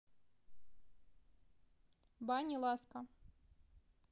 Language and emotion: Russian, neutral